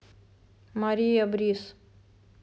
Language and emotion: Russian, neutral